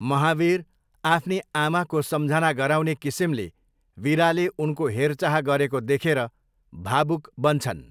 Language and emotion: Nepali, neutral